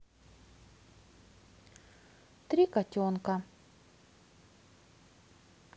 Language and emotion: Russian, sad